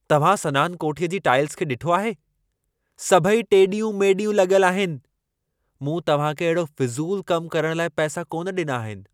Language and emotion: Sindhi, angry